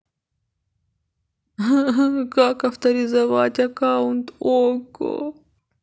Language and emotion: Russian, sad